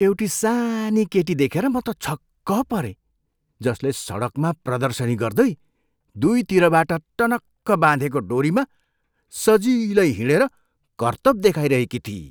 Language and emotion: Nepali, surprised